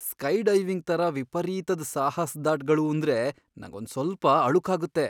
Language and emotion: Kannada, fearful